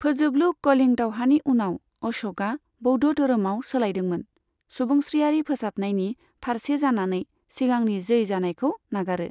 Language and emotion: Bodo, neutral